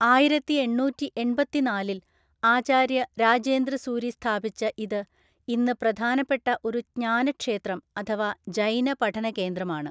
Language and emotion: Malayalam, neutral